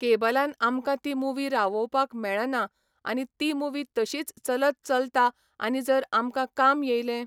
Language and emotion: Goan Konkani, neutral